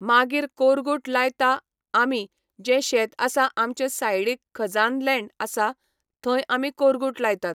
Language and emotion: Goan Konkani, neutral